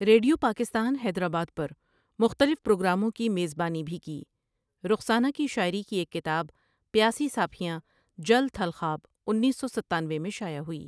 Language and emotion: Urdu, neutral